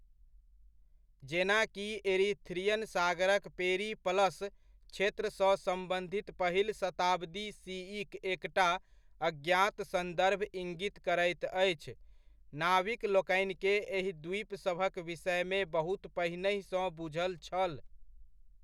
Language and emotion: Maithili, neutral